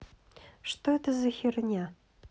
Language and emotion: Russian, neutral